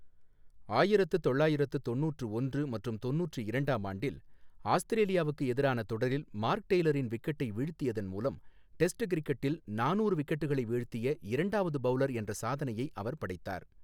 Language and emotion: Tamil, neutral